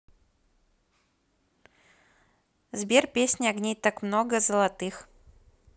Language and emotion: Russian, positive